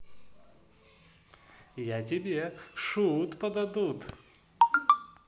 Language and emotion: Russian, positive